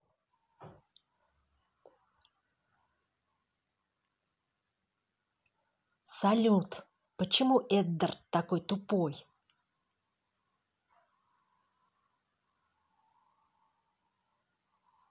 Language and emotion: Russian, angry